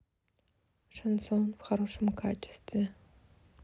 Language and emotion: Russian, neutral